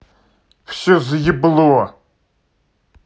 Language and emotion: Russian, angry